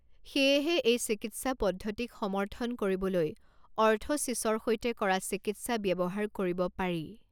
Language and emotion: Assamese, neutral